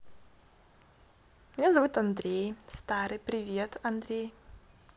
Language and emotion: Russian, positive